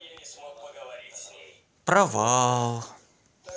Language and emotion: Russian, neutral